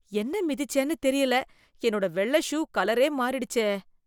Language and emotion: Tamil, disgusted